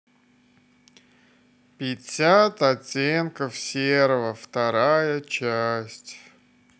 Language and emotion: Russian, sad